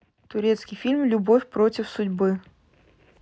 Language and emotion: Russian, neutral